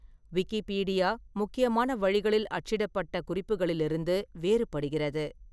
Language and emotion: Tamil, neutral